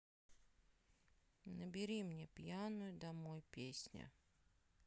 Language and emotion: Russian, sad